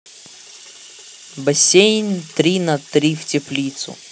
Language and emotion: Russian, neutral